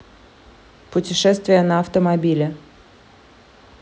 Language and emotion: Russian, neutral